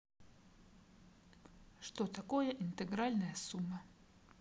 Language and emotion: Russian, neutral